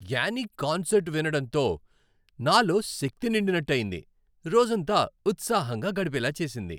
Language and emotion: Telugu, happy